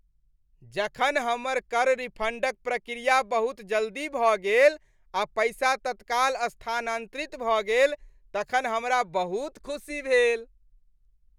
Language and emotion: Maithili, happy